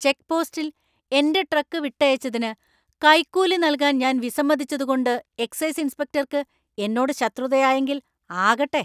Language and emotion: Malayalam, angry